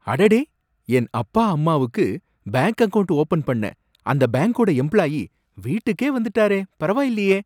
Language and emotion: Tamil, surprised